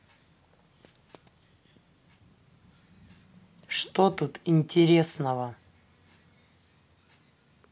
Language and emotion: Russian, angry